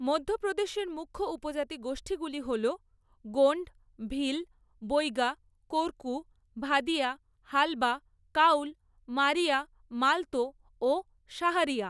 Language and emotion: Bengali, neutral